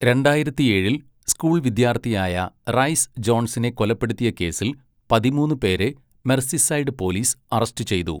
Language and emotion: Malayalam, neutral